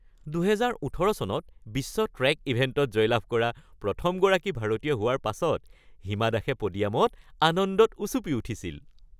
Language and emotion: Assamese, happy